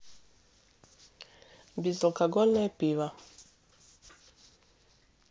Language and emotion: Russian, neutral